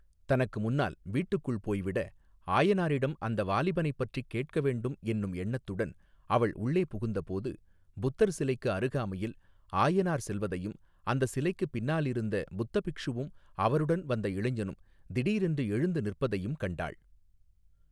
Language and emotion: Tamil, neutral